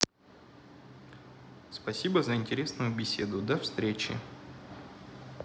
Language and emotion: Russian, neutral